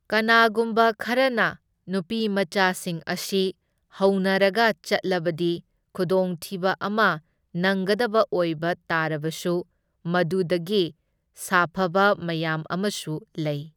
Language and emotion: Manipuri, neutral